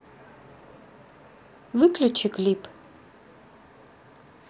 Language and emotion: Russian, neutral